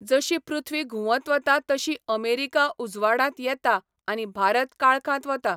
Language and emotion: Goan Konkani, neutral